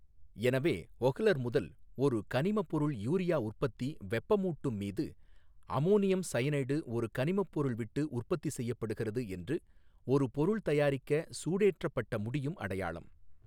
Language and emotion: Tamil, neutral